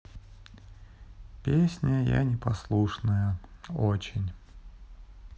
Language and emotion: Russian, sad